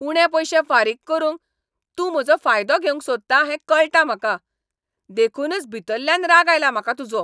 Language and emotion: Goan Konkani, angry